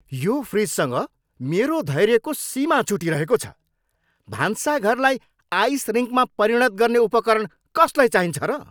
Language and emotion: Nepali, angry